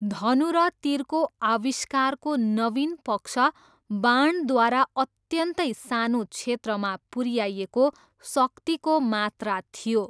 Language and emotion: Nepali, neutral